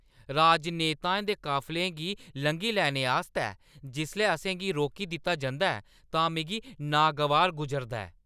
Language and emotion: Dogri, angry